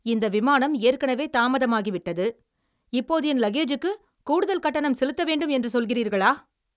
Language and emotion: Tamil, angry